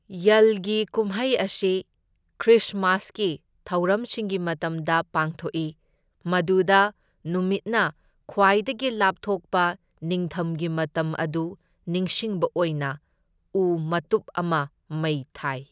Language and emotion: Manipuri, neutral